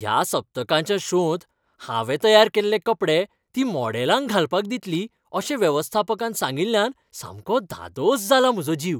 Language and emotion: Goan Konkani, happy